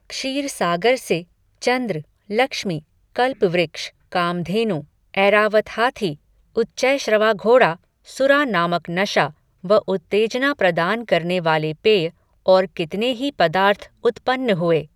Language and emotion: Hindi, neutral